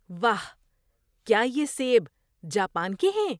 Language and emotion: Urdu, surprised